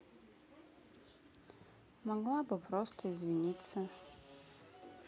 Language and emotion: Russian, sad